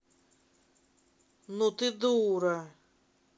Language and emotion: Russian, angry